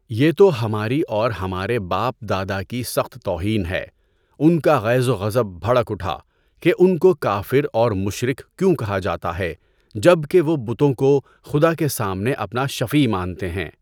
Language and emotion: Urdu, neutral